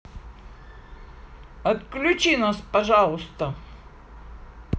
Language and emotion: Russian, positive